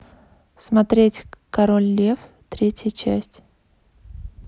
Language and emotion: Russian, neutral